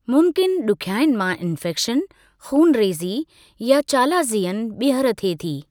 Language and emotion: Sindhi, neutral